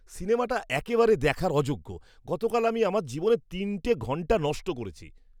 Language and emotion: Bengali, disgusted